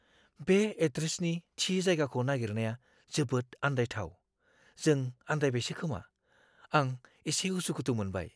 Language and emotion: Bodo, fearful